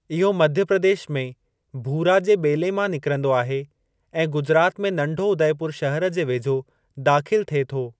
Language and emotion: Sindhi, neutral